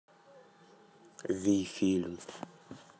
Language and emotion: Russian, neutral